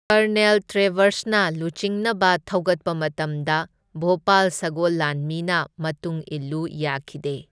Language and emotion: Manipuri, neutral